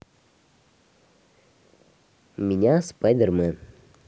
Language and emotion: Russian, neutral